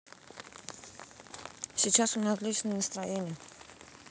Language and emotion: Russian, neutral